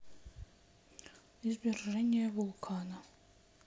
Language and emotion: Russian, sad